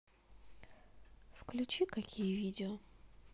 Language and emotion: Russian, neutral